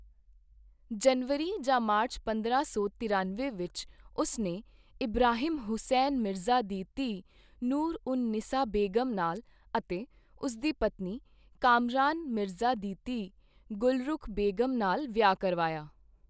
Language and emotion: Punjabi, neutral